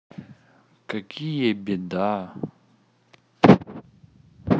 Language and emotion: Russian, neutral